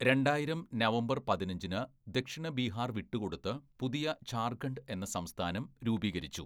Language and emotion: Malayalam, neutral